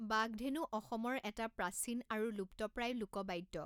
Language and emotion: Assamese, neutral